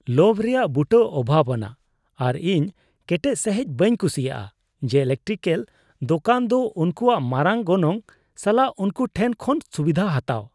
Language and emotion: Santali, disgusted